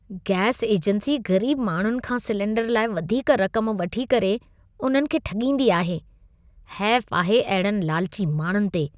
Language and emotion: Sindhi, disgusted